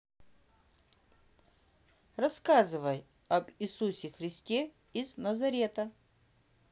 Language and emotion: Russian, neutral